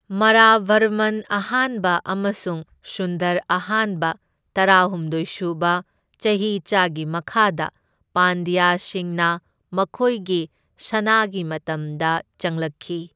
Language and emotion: Manipuri, neutral